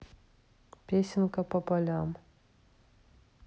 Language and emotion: Russian, neutral